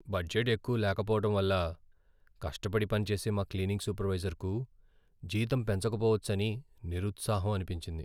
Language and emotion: Telugu, sad